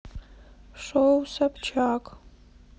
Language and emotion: Russian, sad